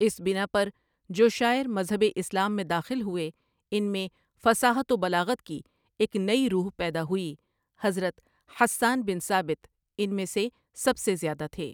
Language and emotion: Urdu, neutral